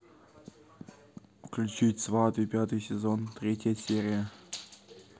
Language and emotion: Russian, neutral